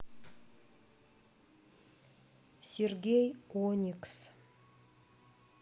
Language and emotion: Russian, neutral